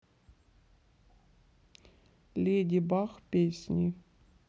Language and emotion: Russian, neutral